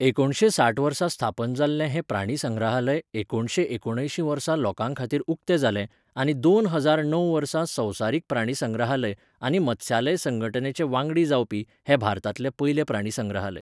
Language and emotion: Goan Konkani, neutral